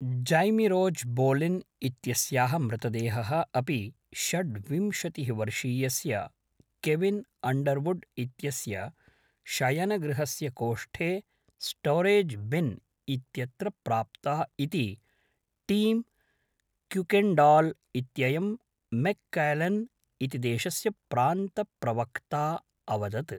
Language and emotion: Sanskrit, neutral